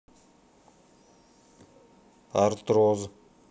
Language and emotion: Russian, neutral